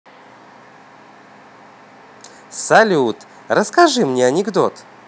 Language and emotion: Russian, positive